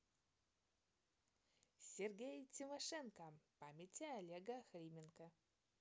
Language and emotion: Russian, positive